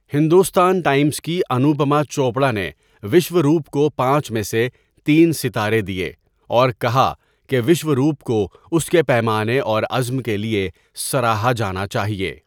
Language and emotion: Urdu, neutral